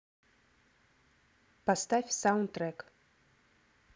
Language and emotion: Russian, neutral